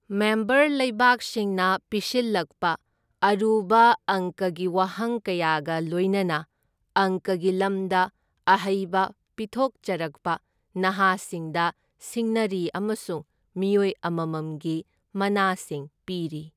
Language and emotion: Manipuri, neutral